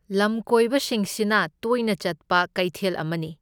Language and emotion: Manipuri, neutral